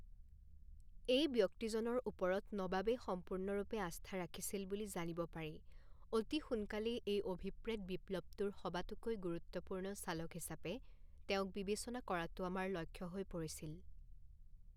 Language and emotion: Assamese, neutral